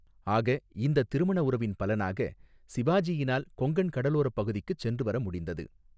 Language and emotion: Tamil, neutral